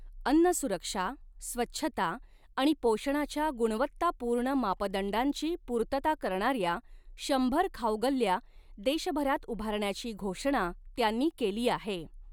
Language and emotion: Marathi, neutral